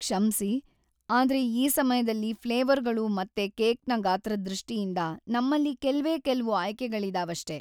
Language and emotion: Kannada, sad